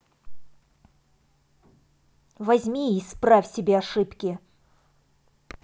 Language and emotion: Russian, angry